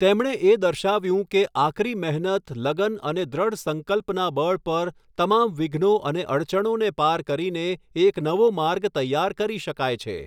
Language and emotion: Gujarati, neutral